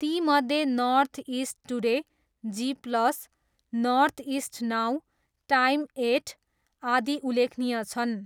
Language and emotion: Nepali, neutral